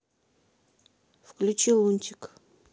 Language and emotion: Russian, neutral